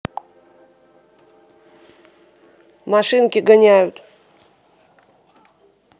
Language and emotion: Russian, neutral